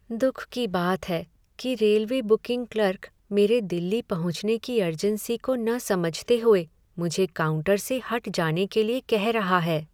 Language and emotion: Hindi, sad